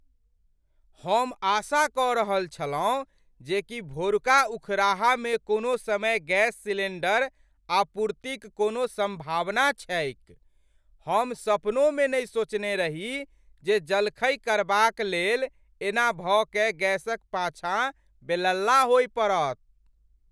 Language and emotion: Maithili, surprised